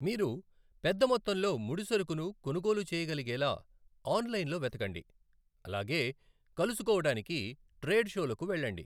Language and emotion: Telugu, neutral